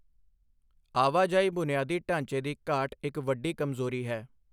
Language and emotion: Punjabi, neutral